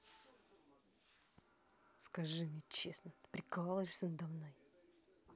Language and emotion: Russian, angry